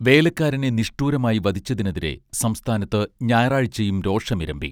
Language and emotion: Malayalam, neutral